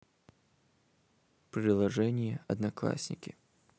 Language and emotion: Russian, neutral